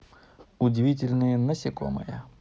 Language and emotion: Russian, positive